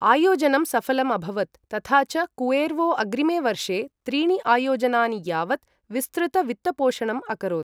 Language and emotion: Sanskrit, neutral